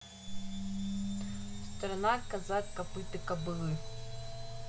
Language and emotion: Russian, neutral